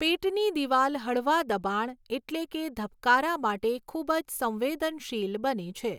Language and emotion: Gujarati, neutral